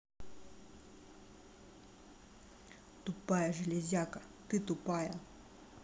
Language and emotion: Russian, angry